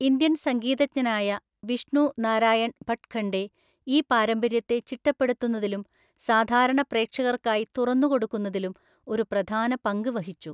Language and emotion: Malayalam, neutral